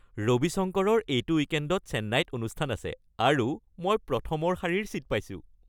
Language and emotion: Assamese, happy